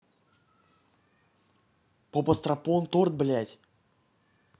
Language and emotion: Russian, angry